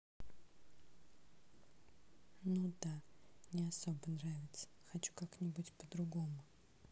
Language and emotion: Russian, sad